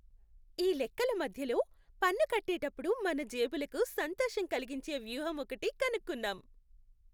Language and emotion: Telugu, happy